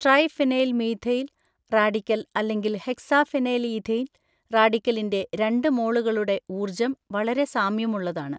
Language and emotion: Malayalam, neutral